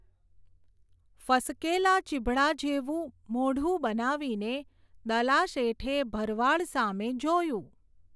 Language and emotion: Gujarati, neutral